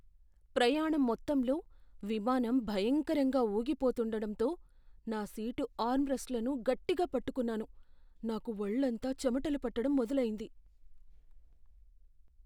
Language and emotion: Telugu, fearful